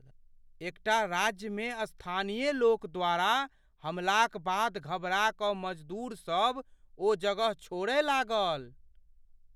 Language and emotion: Maithili, fearful